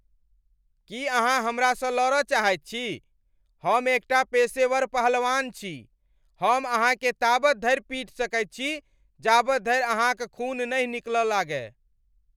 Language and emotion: Maithili, angry